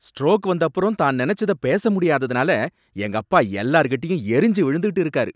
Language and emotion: Tamil, angry